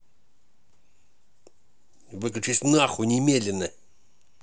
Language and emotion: Russian, angry